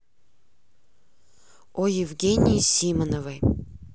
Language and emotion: Russian, neutral